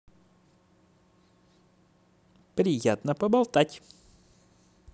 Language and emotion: Russian, positive